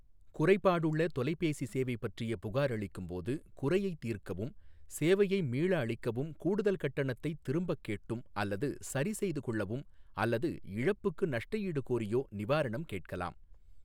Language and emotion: Tamil, neutral